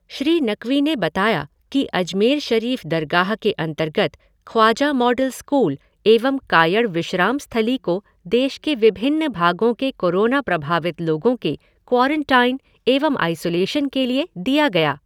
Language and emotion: Hindi, neutral